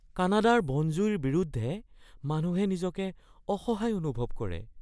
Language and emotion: Assamese, fearful